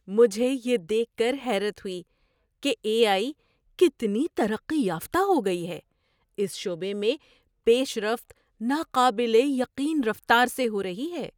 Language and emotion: Urdu, surprised